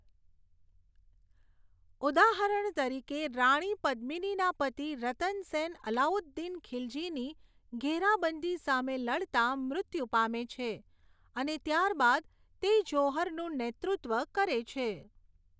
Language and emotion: Gujarati, neutral